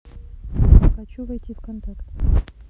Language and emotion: Russian, neutral